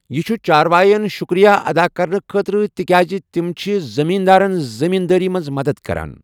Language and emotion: Kashmiri, neutral